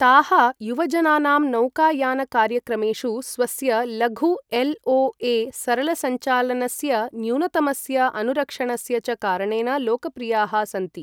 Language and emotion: Sanskrit, neutral